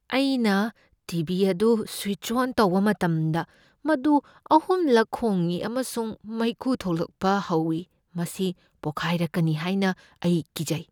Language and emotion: Manipuri, fearful